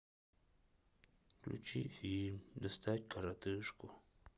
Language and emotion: Russian, sad